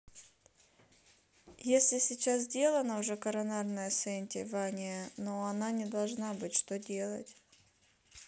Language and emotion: Russian, neutral